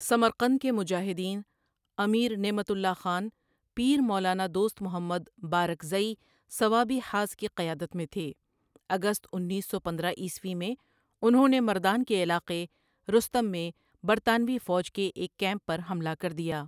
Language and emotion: Urdu, neutral